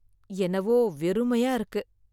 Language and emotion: Tamil, sad